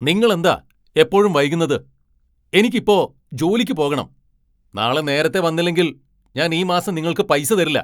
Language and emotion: Malayalam, angry